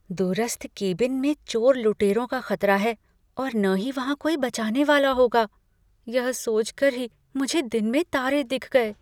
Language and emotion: Hindi, fearful